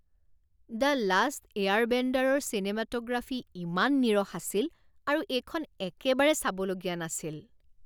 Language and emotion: Assamese, disgusted